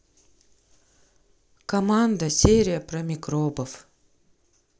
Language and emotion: Russian, neutral